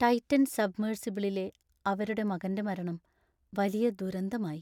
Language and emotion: Malayalam, sad